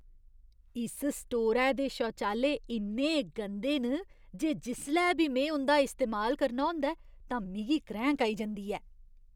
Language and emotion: Dogri, disgusted